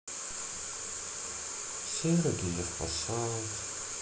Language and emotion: Russian, sad